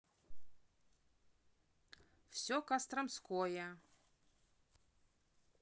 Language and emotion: Russian, neutral